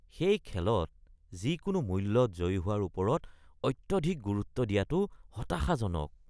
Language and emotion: Assamese, disgusted